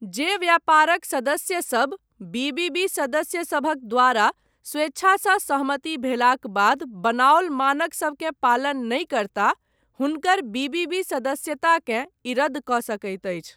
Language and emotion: Maithili, neutral